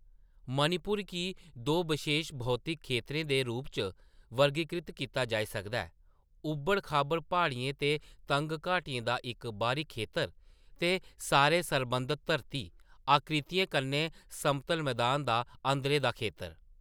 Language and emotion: Dogri, neutral